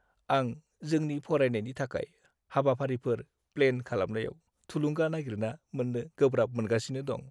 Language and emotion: Bodo, sad